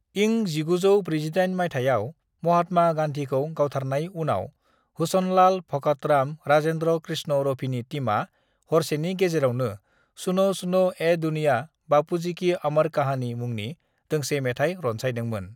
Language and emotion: Bodo, neutral